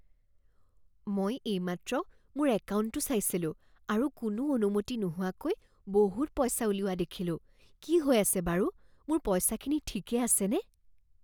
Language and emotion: Assamese, fearful